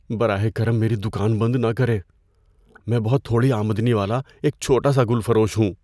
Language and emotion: Urdu, fearful